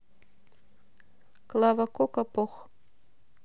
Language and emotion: Russian, neutral